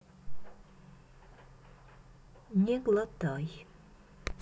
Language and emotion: Russian, neutral